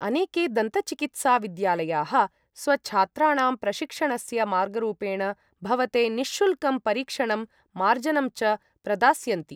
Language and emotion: Sanskrit, neutral